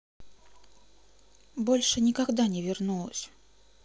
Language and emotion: Russian, sad